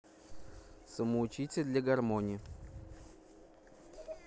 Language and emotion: Russian, neutral